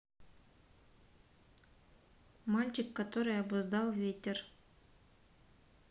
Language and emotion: Russian, neutral